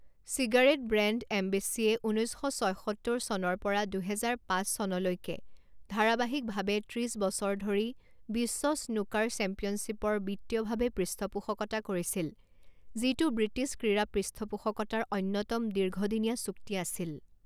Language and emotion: Assamese, neutral